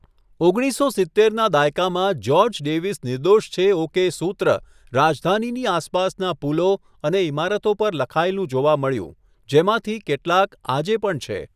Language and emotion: Gujarati, neutral